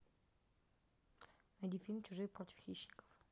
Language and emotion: Russian, neutral